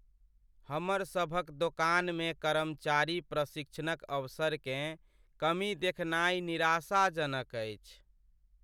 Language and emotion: Maithili, sad